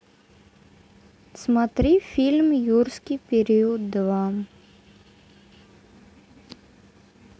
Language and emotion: Russian, neutral